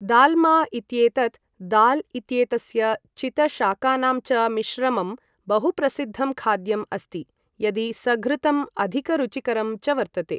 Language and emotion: Sanskrit, neutral